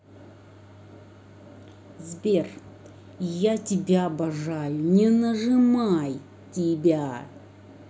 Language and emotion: Russian, angry